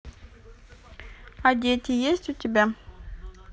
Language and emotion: Russian, neutral